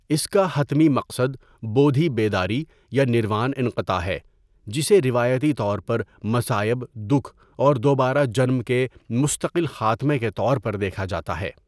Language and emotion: Urdu, neutral